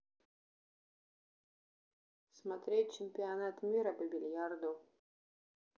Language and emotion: Russian, neutral